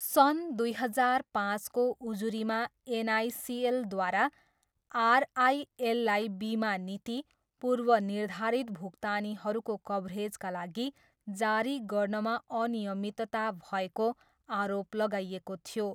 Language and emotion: Nepali, neutral